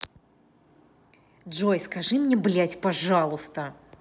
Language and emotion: Russian, angry